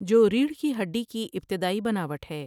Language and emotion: Urdu, neutral